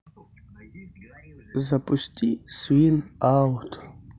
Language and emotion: Russian, neutral